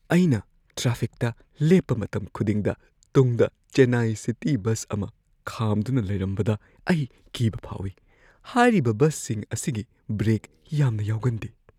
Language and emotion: Manipuri, fearful